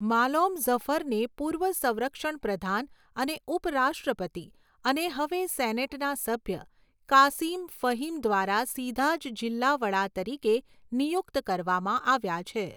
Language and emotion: Gujarati, neutral